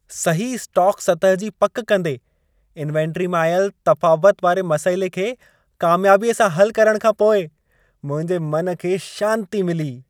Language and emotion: Sindhi, happy